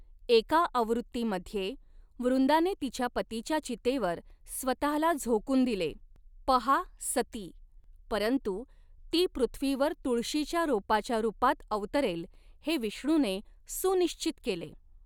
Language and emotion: Marathi, neutral